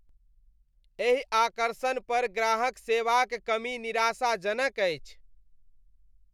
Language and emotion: Maithili, disgusted